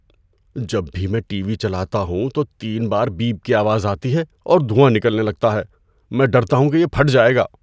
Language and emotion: Urdu, fearful